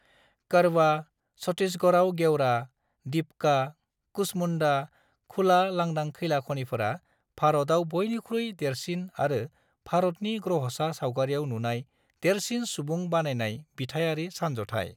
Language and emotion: Bodo, neutral